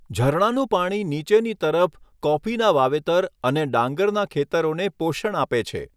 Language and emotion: Gujarati, neutral